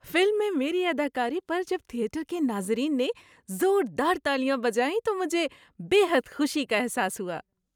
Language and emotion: Urdu, happy